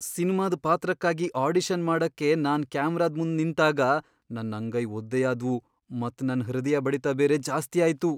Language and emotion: Kannada, fearful